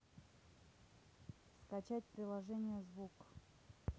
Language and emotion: Russian, neutral